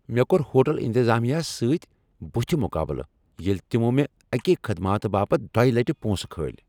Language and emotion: Kashmiri, angry